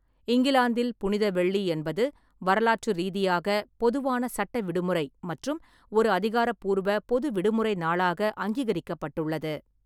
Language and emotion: Tamil, neutral